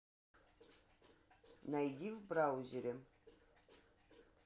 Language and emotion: Russian, neutral